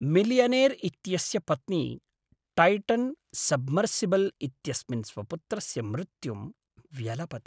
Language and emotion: Sanskrit, sad